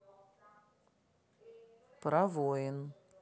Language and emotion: Russian, neutral